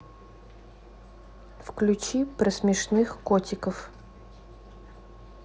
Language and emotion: Russian, neutral